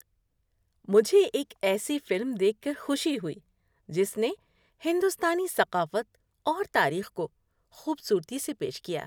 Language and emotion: Urdu, happy